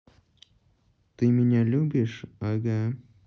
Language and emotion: Russian, neutral